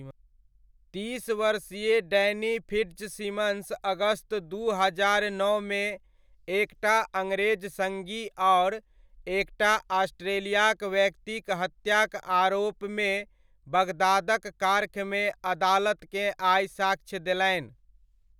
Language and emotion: Maithili, neutral